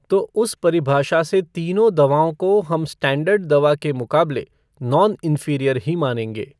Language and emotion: Hindi, neutral